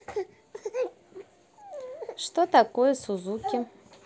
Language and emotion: Russian, neutral